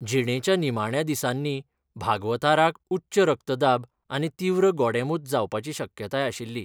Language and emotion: Goan Konkani, neutral